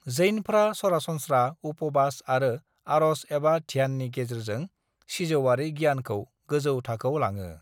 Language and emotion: Bodo, neutral